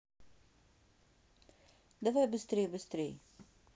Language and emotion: Russian, neutral